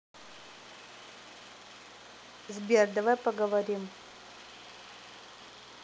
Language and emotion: Russian, neutral